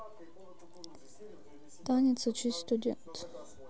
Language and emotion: Russian, sad